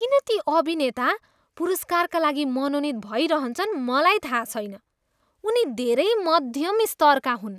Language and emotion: Nepali, disgusted